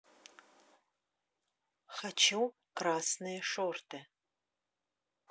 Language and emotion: Russian, neutral